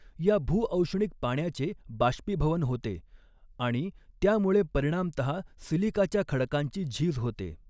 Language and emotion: Marathi, neutral